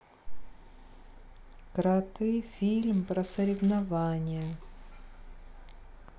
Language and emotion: Russian, neutral